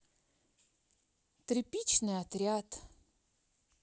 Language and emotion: Russian, neutral